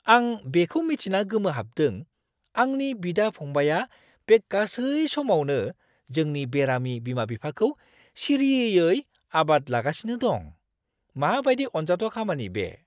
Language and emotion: Bodo, surprised